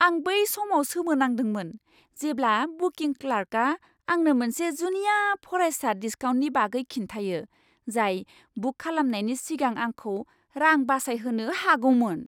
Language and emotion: Bodo, surprised